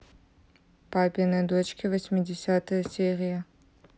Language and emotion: Russian, neutral